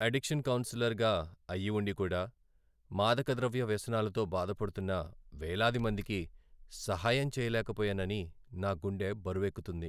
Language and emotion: Telugu, sad